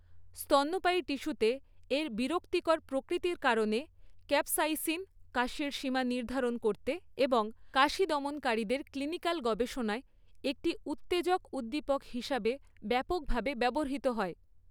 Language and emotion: Bengali, neutral